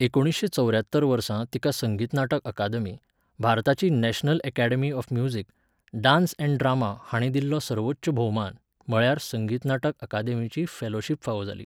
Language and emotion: Goan Konkani, neutral